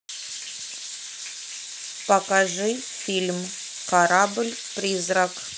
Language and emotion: Russian, neutral